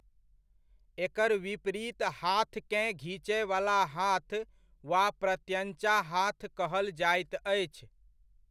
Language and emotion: Maithili, neutral